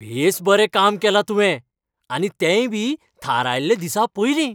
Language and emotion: Goan Konkani, happy